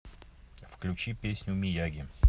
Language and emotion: Russian, neutral